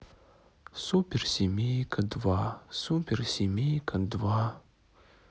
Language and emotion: Russian, sad